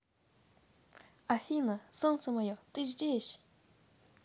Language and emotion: Russian, positive